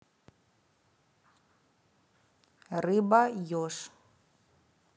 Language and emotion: Russian, neutral